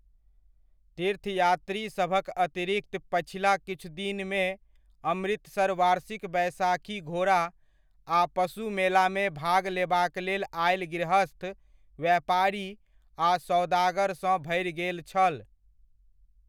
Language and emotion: Maithili, neutral